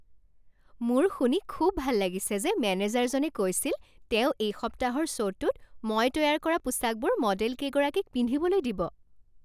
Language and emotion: Assamese, happy